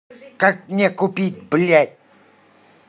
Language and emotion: Russian, angry